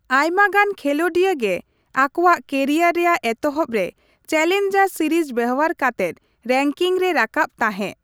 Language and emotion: Santali, neutral